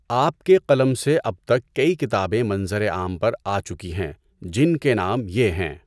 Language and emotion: Urdu, neutral